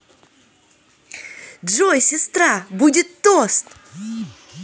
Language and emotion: Russian, positive